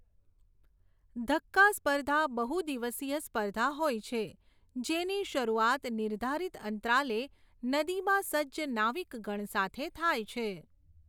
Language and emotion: Gujarati, neutral